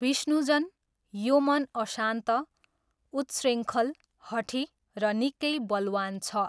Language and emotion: Nepali, neutral